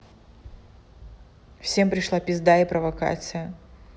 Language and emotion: Russian, neutral